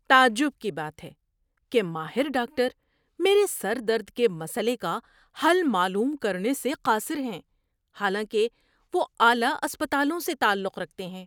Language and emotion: Urdu, surprised